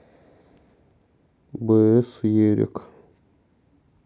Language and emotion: Russian, neutral